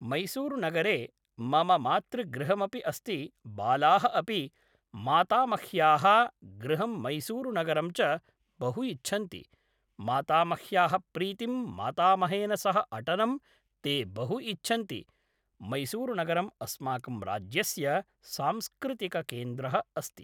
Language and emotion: Sanskrit, neutral